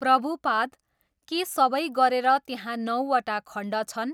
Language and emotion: Nepali, neutral